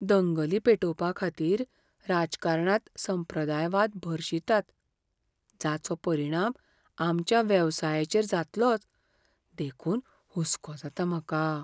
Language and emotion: Goan Konkani, fearful